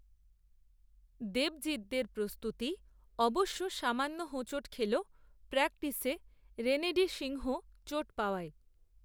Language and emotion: Bengali, neutral